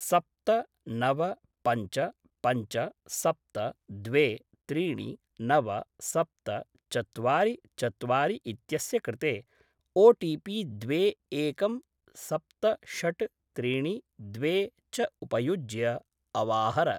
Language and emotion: Sanskrit, neutral